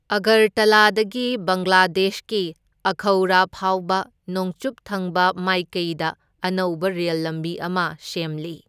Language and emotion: Manipuri, neutral